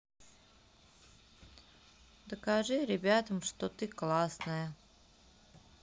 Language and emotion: Russian, neutral